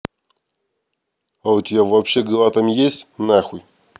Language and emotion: Russian, angry